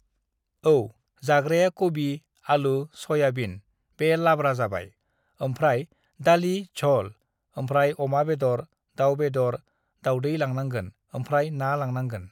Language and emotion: Bodo, neutral